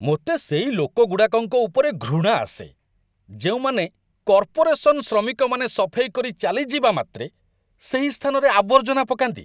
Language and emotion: Odia, disgusted